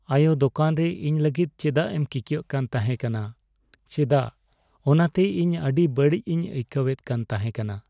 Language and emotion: Santali, sad